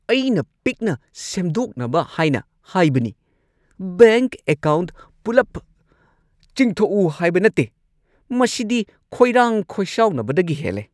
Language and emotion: Manipuri, angry